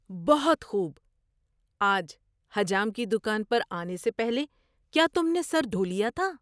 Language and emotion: Urdu, surprised